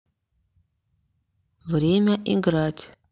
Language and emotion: Russian, neutral